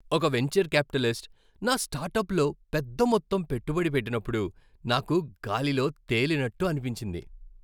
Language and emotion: Telugu, happy